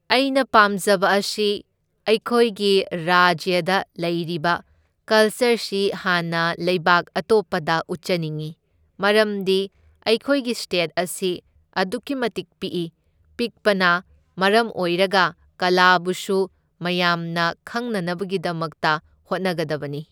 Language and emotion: Manipuri, neutral